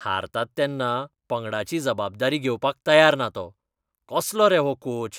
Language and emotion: Goan Konkani, disgusted